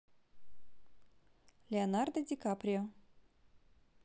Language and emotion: Russian, positive